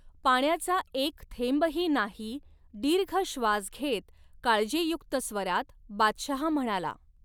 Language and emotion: Marathi, neutral